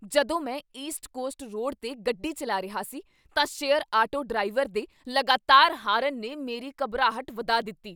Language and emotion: Punjabi, angry